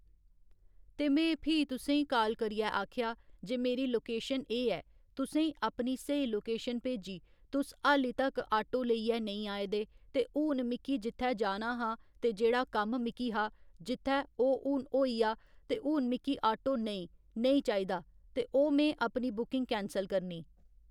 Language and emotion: Dogri, neutral